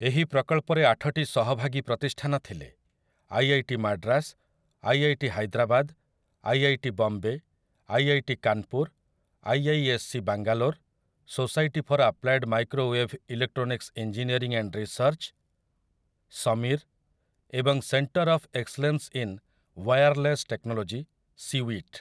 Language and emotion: Odia, neutral